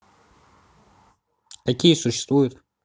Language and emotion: Russian, neutral